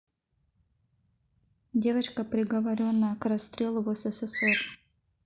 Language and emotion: Russian, neutral